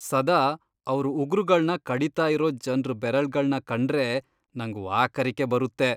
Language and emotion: Kannada, disgusted